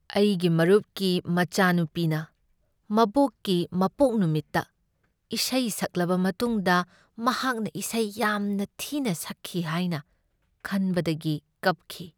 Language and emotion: Manipuri, sad